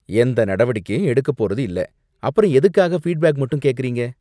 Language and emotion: Tamil, disgusted